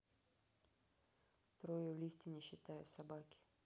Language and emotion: Russian, neutral